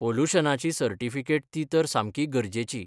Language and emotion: Goan Konkani, neutral